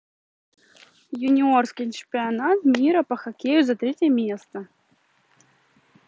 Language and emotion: Russian, neutral